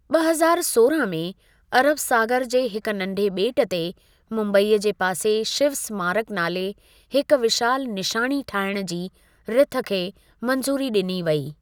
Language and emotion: Sindhi, neutral